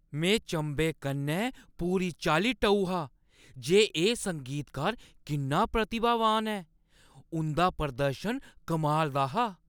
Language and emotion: Dogri, surprised